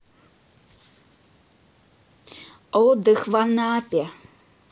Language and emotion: Russian, neutral